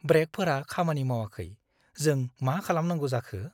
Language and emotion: Bodo, fearful